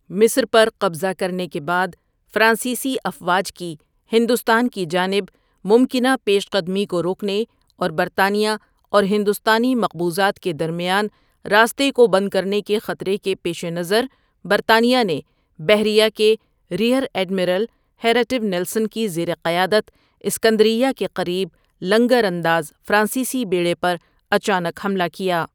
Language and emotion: Urdu, neutral